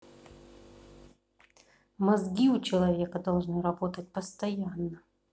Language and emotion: Russian, neutral